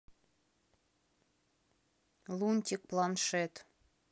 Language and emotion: Russian, neutral